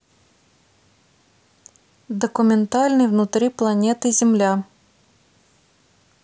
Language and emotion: Russian, neutral